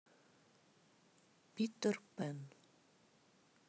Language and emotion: Russian, neutral